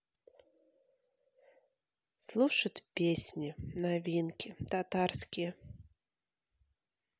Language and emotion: Russian, neutral